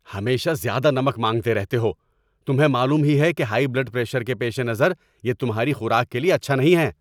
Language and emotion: Urdu, angry